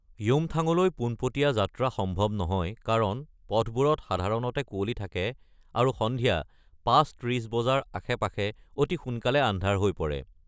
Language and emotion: Assamese, neutral